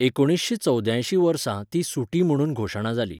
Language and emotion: Goan Konkani, neutral